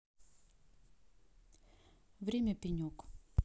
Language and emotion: Russian, neutral